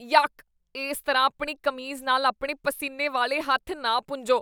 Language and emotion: Punjabi, disgusted